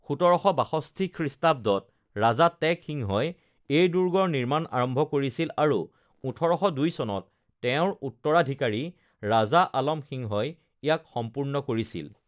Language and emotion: Assamese, neutral